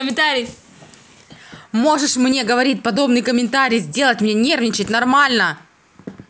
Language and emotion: Russian, angry